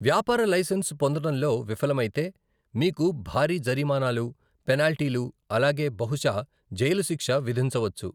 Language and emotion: Telugu, neutral